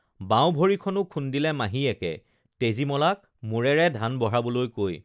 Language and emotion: Assamese, neutral